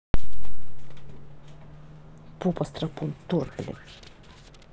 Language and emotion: Russian, angry